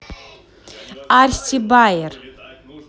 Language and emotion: Russian, positive